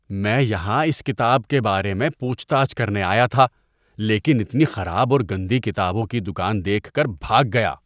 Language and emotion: Urdu, disgusted